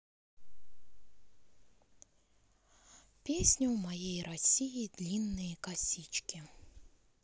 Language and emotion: Russian, sad